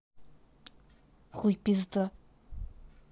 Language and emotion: Russian, angry